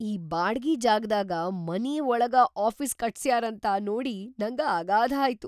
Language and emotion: Kannada, surprised